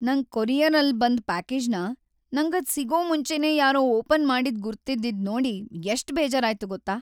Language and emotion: Kannada, sad